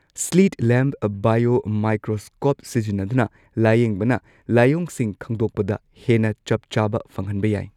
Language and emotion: Manipuri, neutral